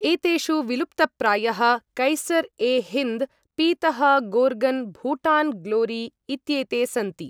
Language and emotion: Sanskrit, neutral